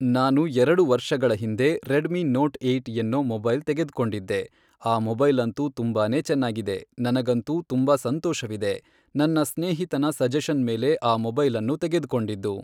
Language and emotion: Kannada, neutral